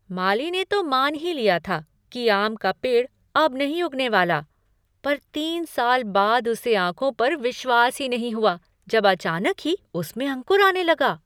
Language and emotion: Hindi, surprised